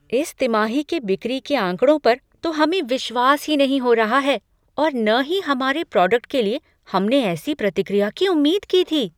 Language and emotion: Hindi, surprised